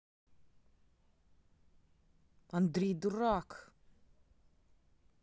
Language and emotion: Russian, angry